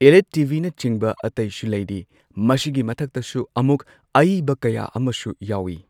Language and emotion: Manipuri, neutral